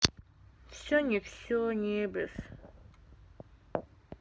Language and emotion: Russian, sad